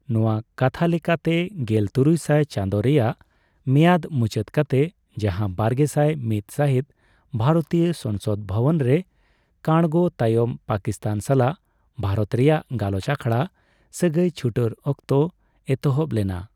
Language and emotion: Santali, neutral